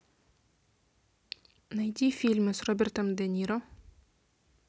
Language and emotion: Russian, neutral